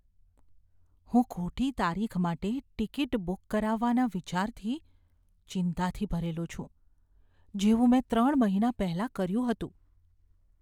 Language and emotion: Gujarati, fearful